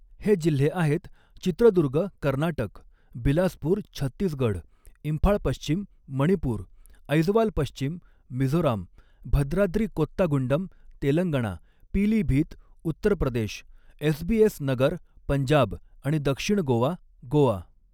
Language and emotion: Marathi, neutral